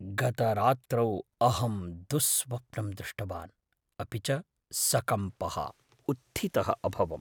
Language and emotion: Sanskrit, fearful